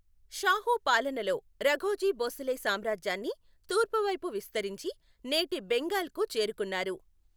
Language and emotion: Telugu, neutral